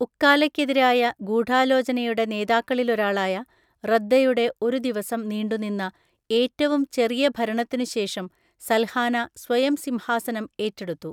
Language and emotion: Malayalam, neutral